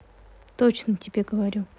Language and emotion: Russian, neutral